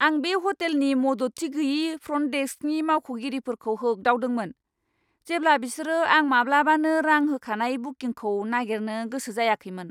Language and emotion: Bodo, angry